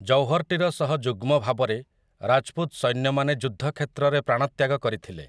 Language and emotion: Odia, neutral